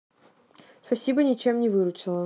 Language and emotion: Russian, angry